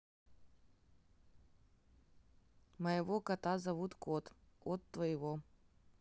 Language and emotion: Russian, neutral